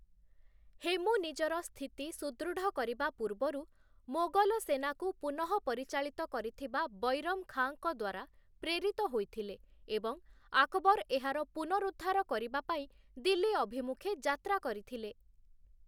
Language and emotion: Odia, neutral